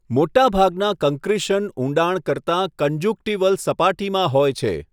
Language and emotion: Gujarati, neutral